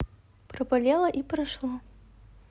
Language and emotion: Russian, neutral